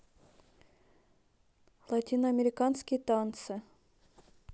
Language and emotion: Russian, neutral